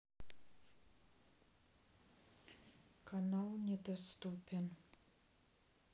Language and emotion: Russian, sad